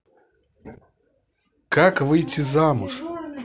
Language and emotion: Russian, neutral